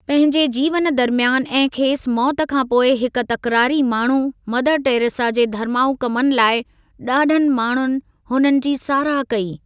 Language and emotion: Sindhi, neutral